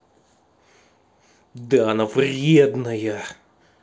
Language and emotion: Russian, angry